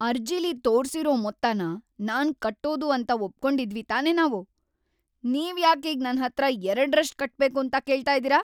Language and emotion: Kannada, angry